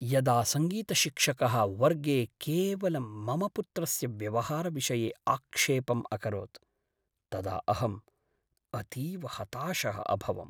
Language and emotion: Sanskrit, sad